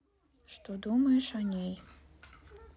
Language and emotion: Russian, neutral